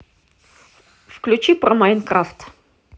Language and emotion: Russian, neutral